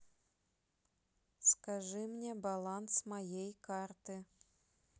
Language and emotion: Russian, neutral